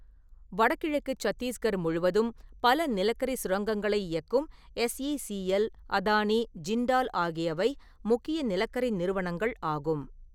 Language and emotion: Tamil, neutral